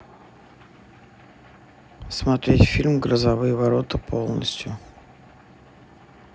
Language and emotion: Russian, neutral